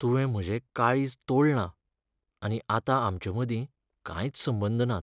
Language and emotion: Goan Konkani, sad